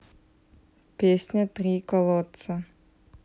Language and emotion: Russian, neutral